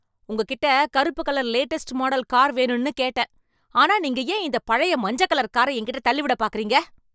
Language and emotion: Tamil, angry